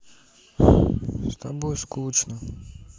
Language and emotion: Russian, sad